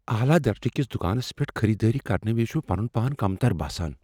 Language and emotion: Kashmiri, fearful